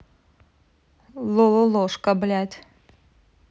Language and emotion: Russian, angry